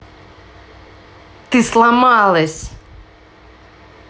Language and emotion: Russian, angry